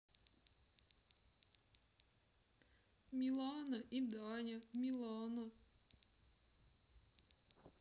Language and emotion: Russian, sad